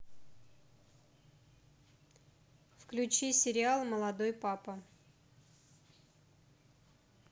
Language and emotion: Russian, neutral